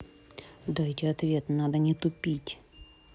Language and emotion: Russian, angry